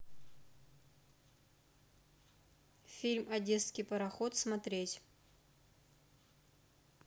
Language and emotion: Russian, neutral